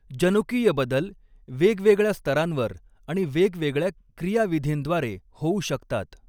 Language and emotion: Marathi, neutral